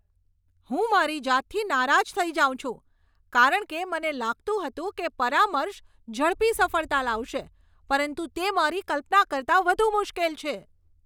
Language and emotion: Gujarati, angry